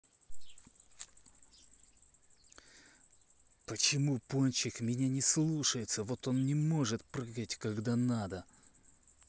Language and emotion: Russian, angry